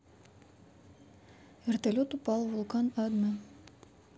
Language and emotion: Russian, neutral